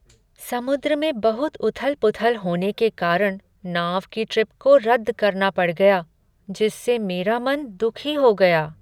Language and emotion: Hindi, sad